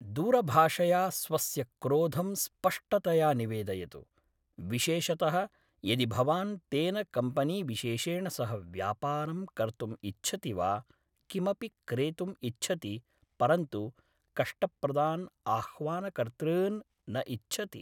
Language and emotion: Sanskrit, neutral